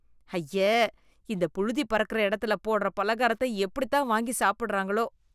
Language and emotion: Tamil, disgusted